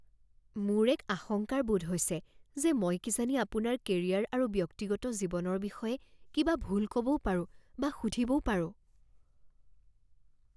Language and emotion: Assamese, fearful